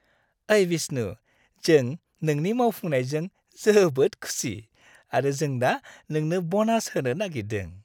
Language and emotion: Bodo, happy